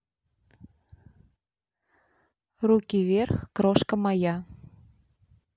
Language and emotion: Russian, neutral